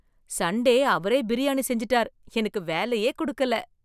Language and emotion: Tamil, surprised